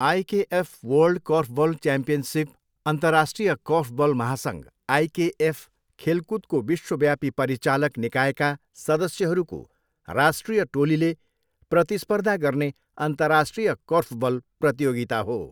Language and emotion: Nepali, neutral